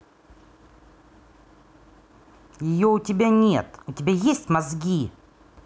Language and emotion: Russian, angry